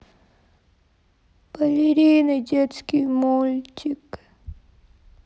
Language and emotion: Russian, sad